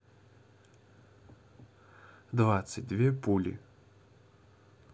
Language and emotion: Russian, neutral